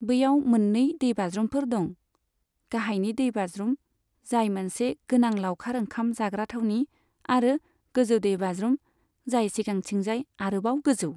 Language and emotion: Bodo, neutral